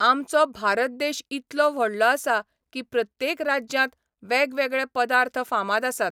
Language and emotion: Goan Konkani, neutral